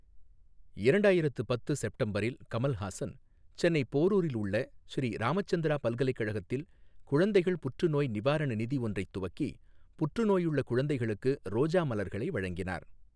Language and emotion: Tamil, neutral